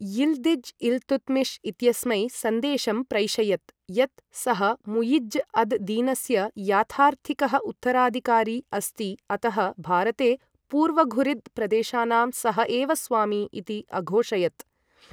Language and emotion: Sanskrit, neutral